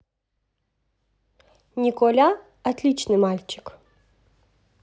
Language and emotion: Russian, positive